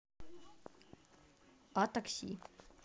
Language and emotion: Russian, neutral